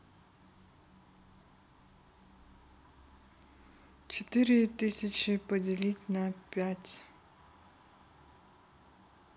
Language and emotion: Russian, neutral